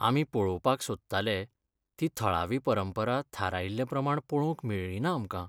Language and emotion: Goan Konkani, sad